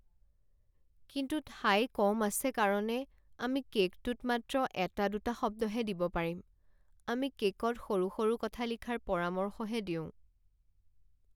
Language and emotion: Assamese, sad